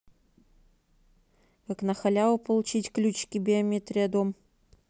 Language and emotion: Russian, neutral